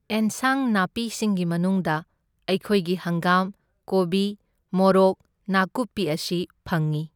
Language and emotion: Manipuri, neutral